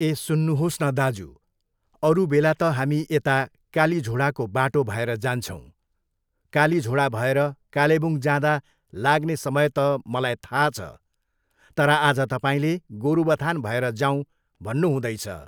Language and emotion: Nepali, neutral